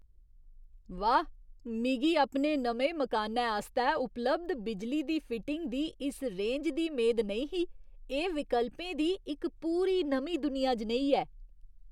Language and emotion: Dogri, surprised